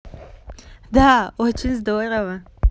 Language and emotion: Russian, positive